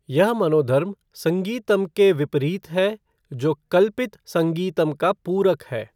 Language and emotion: Hindi, neutral